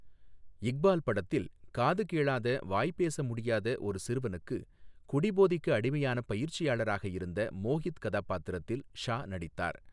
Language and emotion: Tamil, neutral